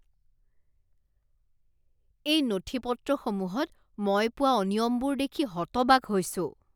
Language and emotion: Assamese, disgusted